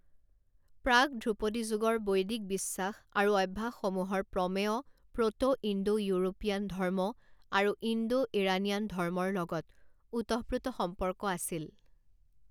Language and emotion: Assamese, neutral